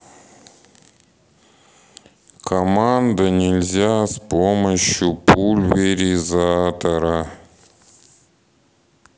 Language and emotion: Russian, sad